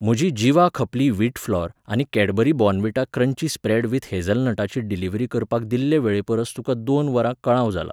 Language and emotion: Goan Konkani, neutral